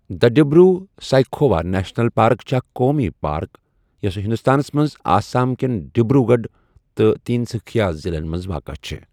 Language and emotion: Kashmiri, neutral